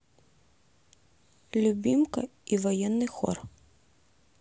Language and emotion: Russian, neutral